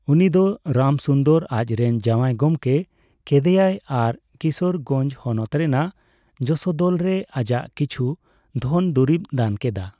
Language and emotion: Santali, neutral